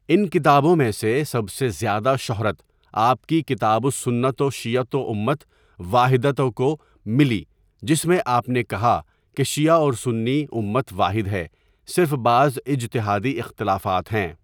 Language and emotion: Urdu, neutral